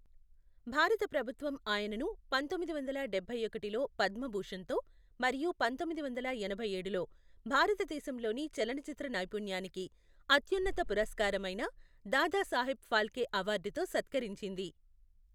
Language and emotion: Telugu, neutral